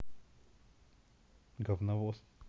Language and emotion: Russian, neutral